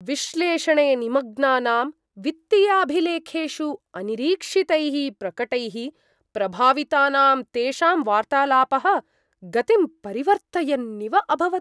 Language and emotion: Sanskrit, surprised